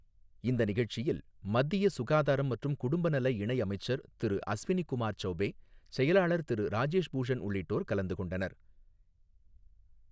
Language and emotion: Tamil, neutral